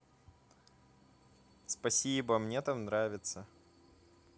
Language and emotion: Russian, positive